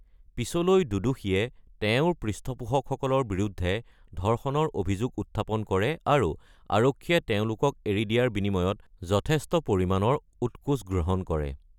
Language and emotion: Assamese, neutral